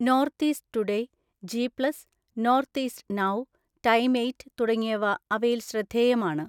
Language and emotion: Malayalam, neutral